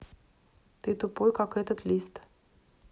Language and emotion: Russian, neutral